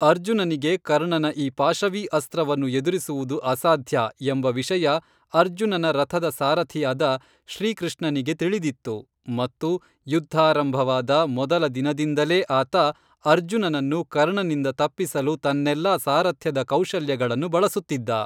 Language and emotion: Kannada, neutral